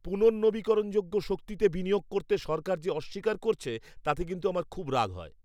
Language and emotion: Bengali, angry